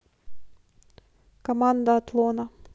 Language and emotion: Russian, neutral